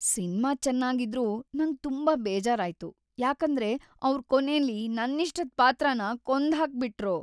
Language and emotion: Kannada, sad